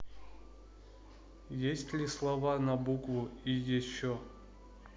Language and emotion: Russian, neutral